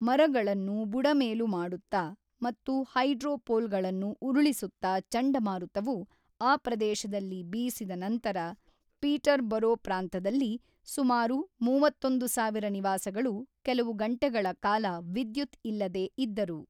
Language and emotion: Kannada, neutral